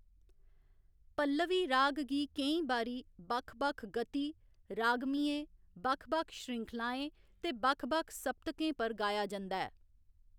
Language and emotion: Dogri, neutral